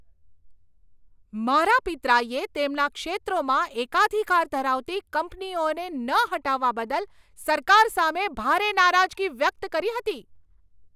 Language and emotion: Gujarati, angry